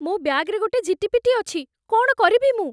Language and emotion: Odia, fearful